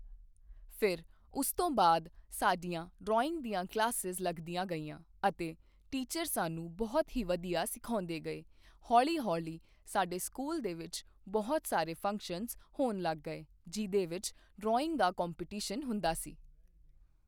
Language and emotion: Punjabi, neutral